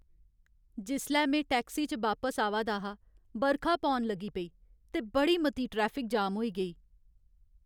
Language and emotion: Dogri, sad